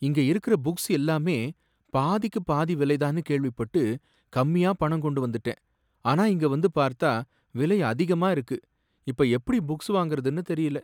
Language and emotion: Tamil, sad